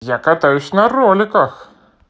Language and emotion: Russian, positive